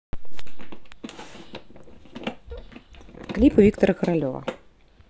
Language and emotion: Russian, neutral